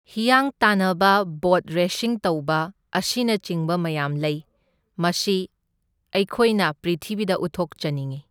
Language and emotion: Manipuri, neutral